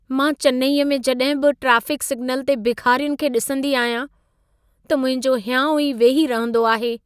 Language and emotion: Sindhi, sad